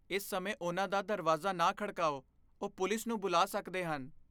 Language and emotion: Punjabi, fearful